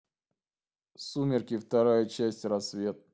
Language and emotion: Russian, neutral